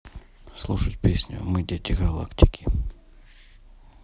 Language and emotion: Russian, neutral